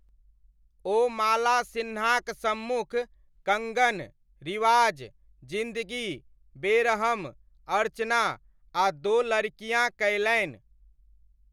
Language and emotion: Maithili, neutral